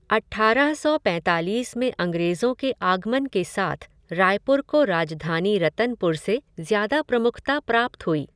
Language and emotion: Hindi, neutral